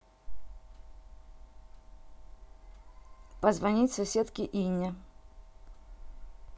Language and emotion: Russian, neutral